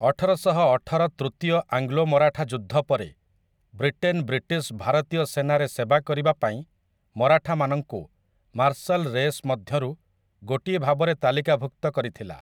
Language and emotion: Odia, neutral